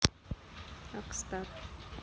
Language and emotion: Russian, neutral